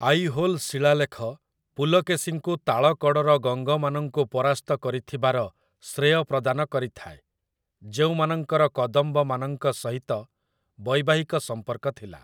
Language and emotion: Odia, neutral